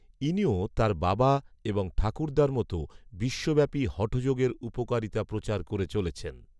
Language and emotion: Bengali, neutral